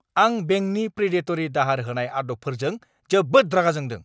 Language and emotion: Bodo, angry